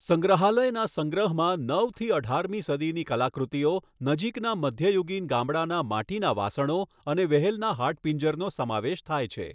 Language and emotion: Gujarati, neutral